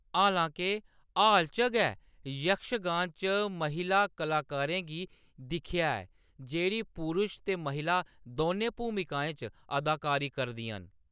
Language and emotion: Dogri, neutral